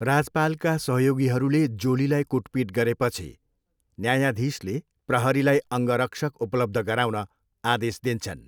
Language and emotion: Nepali, neutral